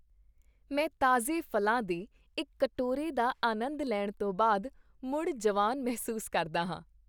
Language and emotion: Punjabi, happy